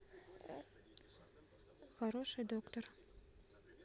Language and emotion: Russian, neutral